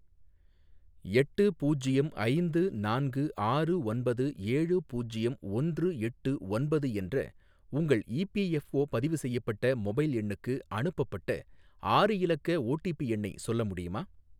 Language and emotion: Tamil, neutral